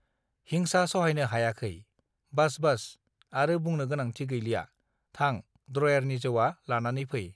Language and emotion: Bodo, neutral